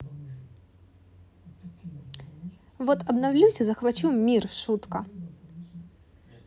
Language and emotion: Russian, neutral